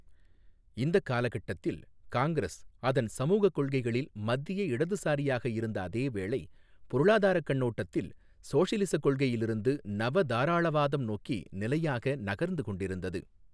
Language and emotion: Tamil, neutral